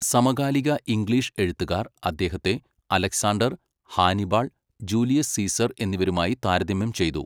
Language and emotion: Malayalam, neutral